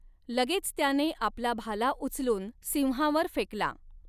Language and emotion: Marathi, neutral